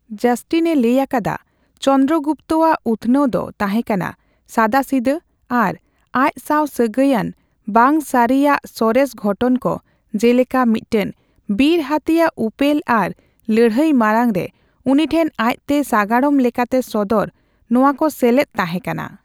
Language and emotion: Santali, neutral